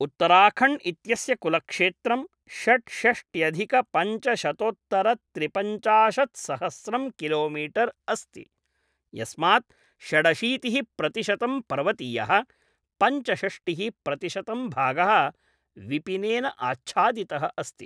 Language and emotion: Sanskrit, neutral